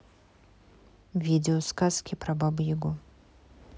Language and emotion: Russian, neutral